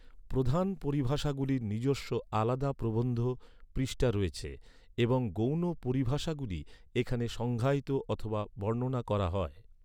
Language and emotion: Bengali, neutral